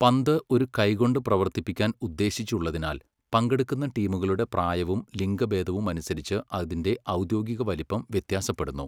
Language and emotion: Malayalam, neutral